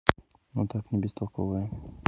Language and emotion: Russian, neutral